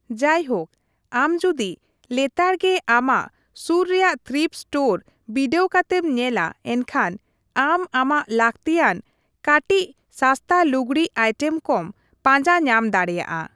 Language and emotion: Santali, neutral